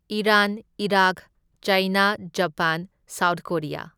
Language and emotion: Manipuri, neutral